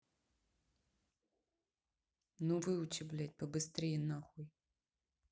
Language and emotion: Russian, angry